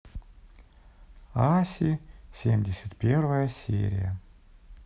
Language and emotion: Russian, neutral